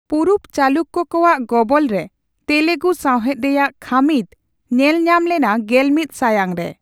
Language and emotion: Santali, neutral